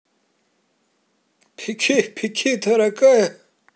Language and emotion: Russian, positive